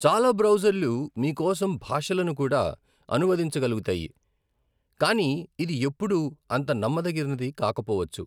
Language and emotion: Telugu, neutral